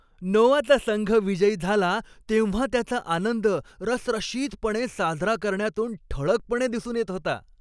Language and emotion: Marathi, happy